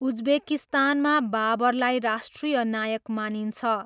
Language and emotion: Nepali, neutral